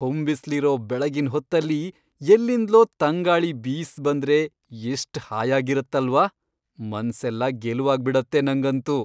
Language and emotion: Kannada, happy